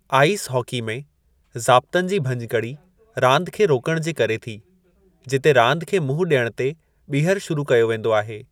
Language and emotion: Sindhi, neutral